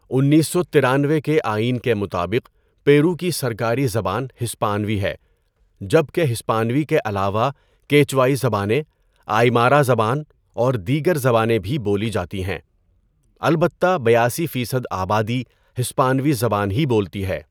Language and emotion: Urdu, neutral